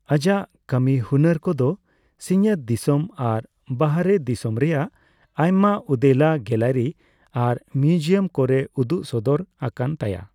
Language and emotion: Santali, neutral